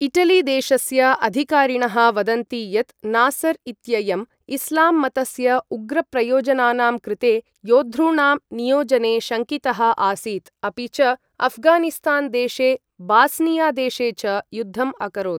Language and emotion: Sanskrit, neutral